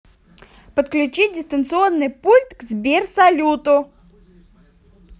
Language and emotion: Russian, positive